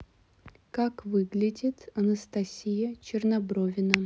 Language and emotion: Russian, neutral